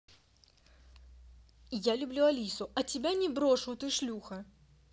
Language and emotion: Russian, angry